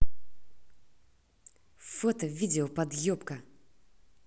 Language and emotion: Russian, angry